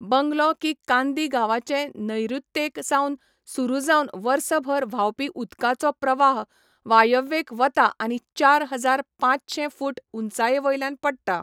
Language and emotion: Goan Konkani, neutral